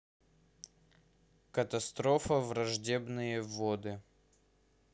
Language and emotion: Russian, neutral